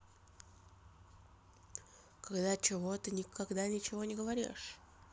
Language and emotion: Russian, neutral